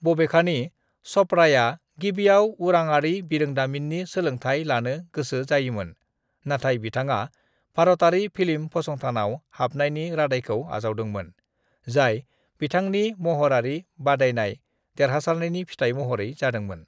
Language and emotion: Bodo, neutral